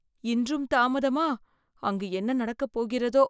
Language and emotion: Tamil, fearful